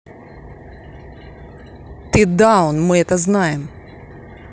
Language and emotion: Russian, angry